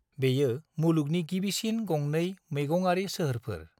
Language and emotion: Bodo, neutral